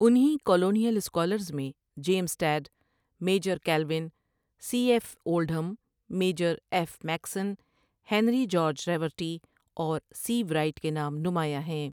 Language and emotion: Urdu, neutral